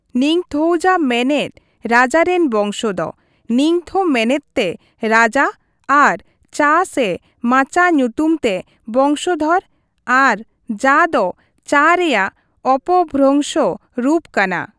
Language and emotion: Santali, neutral